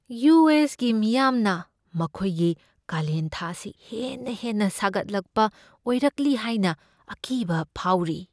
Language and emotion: Manipuri, fearful